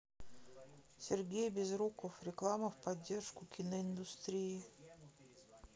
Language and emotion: Russian, neutral